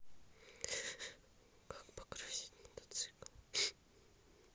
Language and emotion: Russian, sad